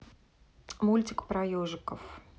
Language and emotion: Russian, neutral